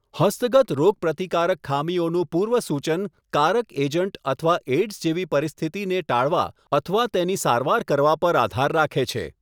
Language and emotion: Gujarati, neutral